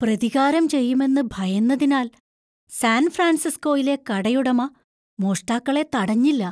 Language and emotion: Malayalam, fearful